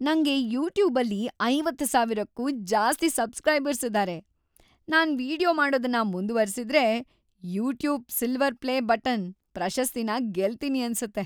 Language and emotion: Kannada, happy